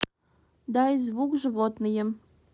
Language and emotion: Russian, neutral